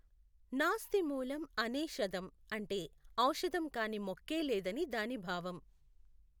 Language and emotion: Telugu, neutral